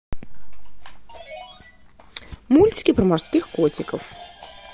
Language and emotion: Russian, positive